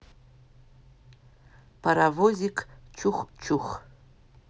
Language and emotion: Russian, neutral